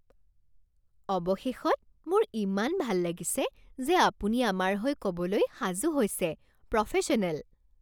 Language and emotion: Assamese, happy